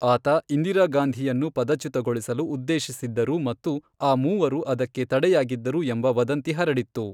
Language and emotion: Kannada, neutral